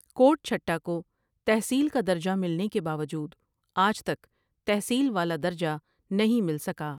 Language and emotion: Urdu, neutral